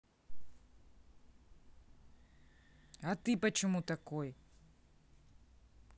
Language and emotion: Russian, angry